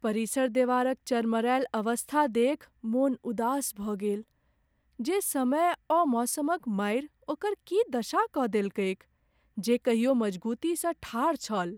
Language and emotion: Maithili, sad